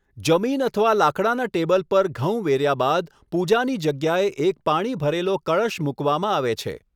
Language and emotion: Gujarati, neutral